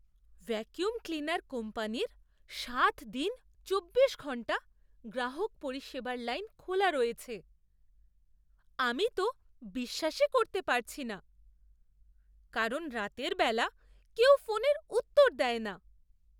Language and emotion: Bengali, surprised